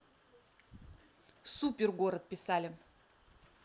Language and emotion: Russian, positive